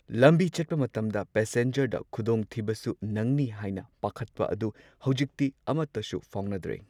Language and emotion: Manipuri, neutral